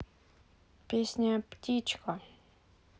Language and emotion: Russian, neutral